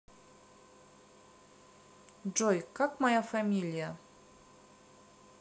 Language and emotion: Russian, neutral